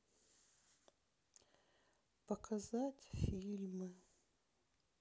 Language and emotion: Russian, sad